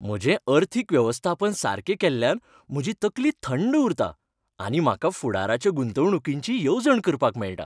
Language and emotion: Goan Konkani, happy